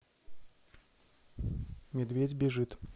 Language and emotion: Russian, neutral